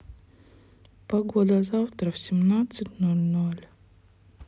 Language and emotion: Russian, sad